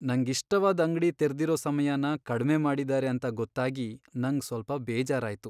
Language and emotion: Kannada, sad